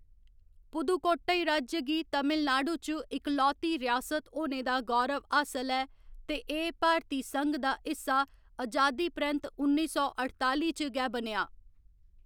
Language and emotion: Dogri, neutral